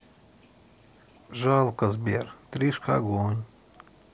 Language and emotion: Russian, sad